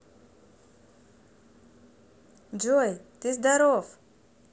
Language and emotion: Russian, positive